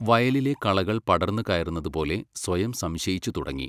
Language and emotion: Malayalam, neutral